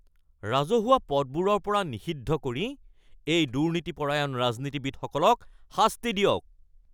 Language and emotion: Assamese, angry